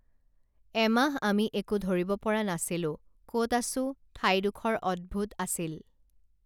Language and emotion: Assamese, neutral